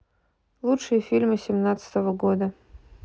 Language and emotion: Russian, neutral